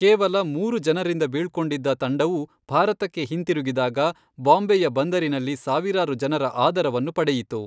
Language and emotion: Kannada, neutral